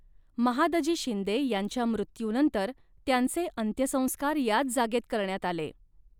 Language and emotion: Marathi, neutral